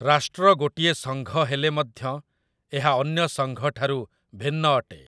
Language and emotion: Odia, neutral